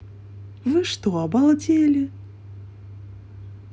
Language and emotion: Russian, neutral